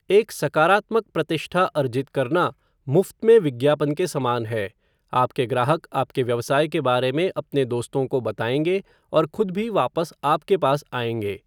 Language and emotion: Hindi, neutral